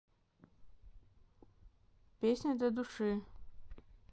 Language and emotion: Russian, neutral